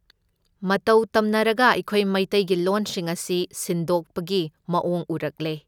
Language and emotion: Manipuri, neutral